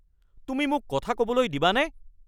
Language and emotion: Assamese, angry